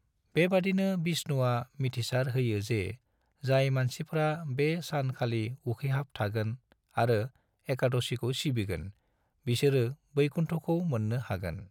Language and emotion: Bodo, neutral